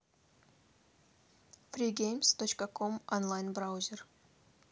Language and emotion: Russian, neutral